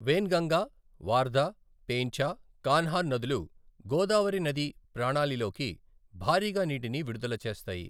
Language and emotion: Telugu, neutral